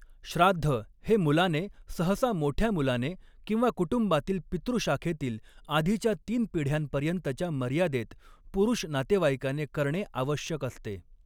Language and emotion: Marathi, neutral